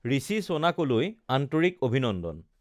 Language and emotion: Assamese, neutral